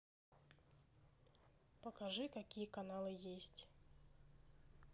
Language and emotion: Russian, neutral